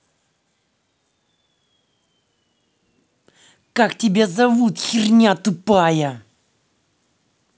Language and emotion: Russian, angry